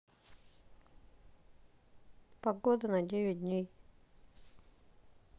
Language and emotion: Russian, neutral